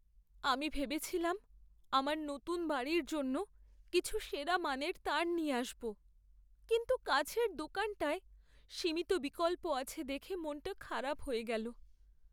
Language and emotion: Bengali, sad